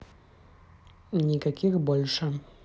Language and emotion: Russian, neutral